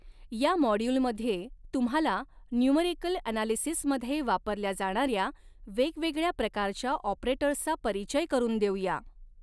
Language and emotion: Marathi, neutral